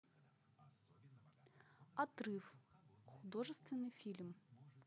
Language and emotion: Russian, neutral